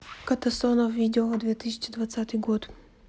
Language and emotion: Russian, neutral